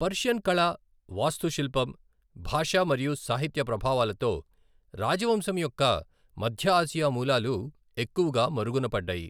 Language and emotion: Telugu, neutral